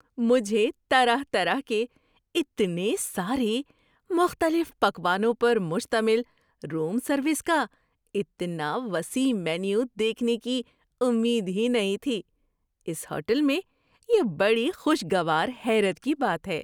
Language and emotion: Urdu, surprised